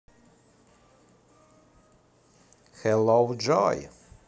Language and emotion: Russian, positive